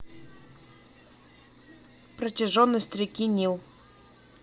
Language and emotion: Russian, neutral